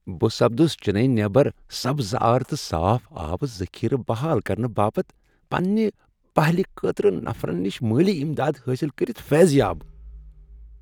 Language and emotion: Kashmiri, happy